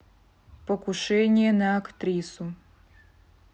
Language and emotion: Russian, neutral